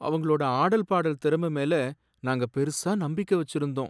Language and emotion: Tamil, sad